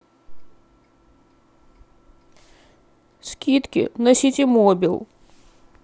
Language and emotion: Russian, sad